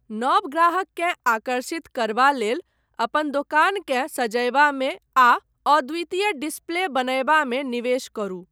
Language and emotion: Maithili, neutral